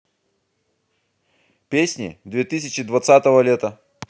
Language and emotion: Russian, positive